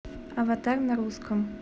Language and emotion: Russian, neutral